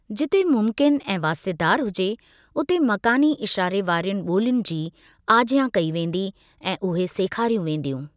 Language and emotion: Sindhi, neutral